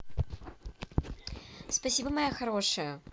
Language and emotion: Russian, positive